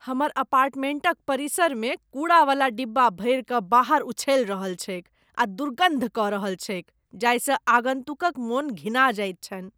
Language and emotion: Maithili, disgusted